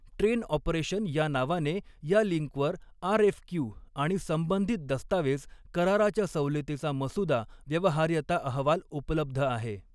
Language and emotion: Marathi, neutral